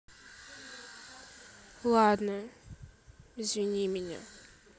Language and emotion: Russian, sad